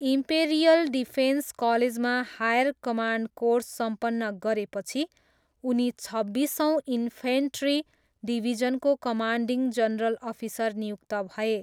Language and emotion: Nepali, neutral